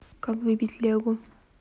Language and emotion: Russian, neutral